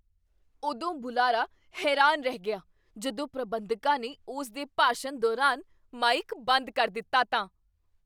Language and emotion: Punjabi, surprised